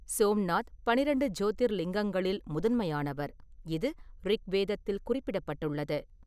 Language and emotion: Tamil, neutral